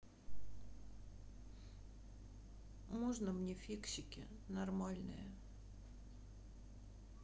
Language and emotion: Russian, sad